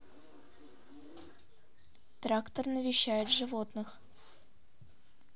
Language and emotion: Russian, neutral